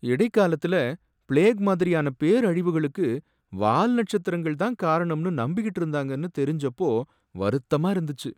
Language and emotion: Tamil, sad